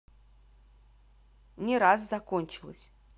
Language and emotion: Russian, neutral